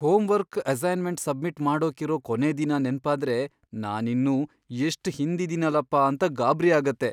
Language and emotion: Kannada, fearful